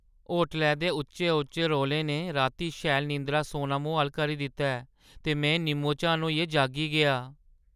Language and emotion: Dogri, sad